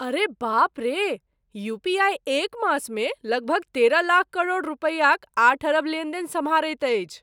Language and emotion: Maithili, surprised